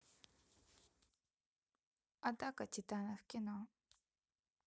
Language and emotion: Russian, neutral